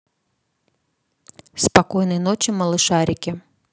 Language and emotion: Russian, neutral